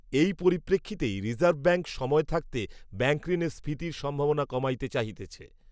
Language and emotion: Bengali, neutral